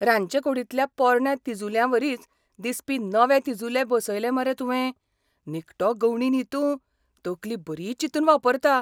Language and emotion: Goan Konkani, surprised